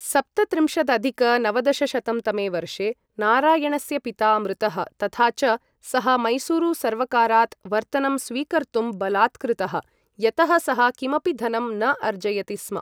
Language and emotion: Sanskrit, neutral